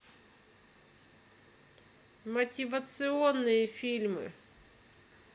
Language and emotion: Russian, neutral